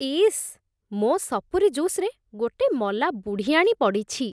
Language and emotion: Odia, disgusted